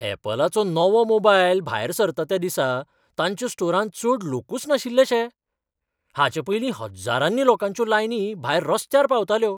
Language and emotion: Goan Konkani, surprised